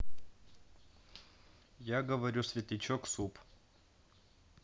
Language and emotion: Russian, neutral